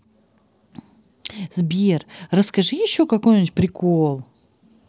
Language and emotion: Russian, positive